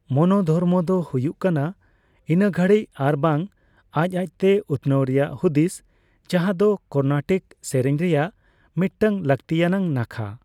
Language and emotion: Santali, neutral